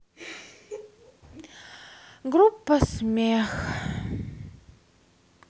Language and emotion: Russian, sad